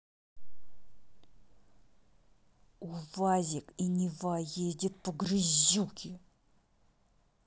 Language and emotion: Russian, angry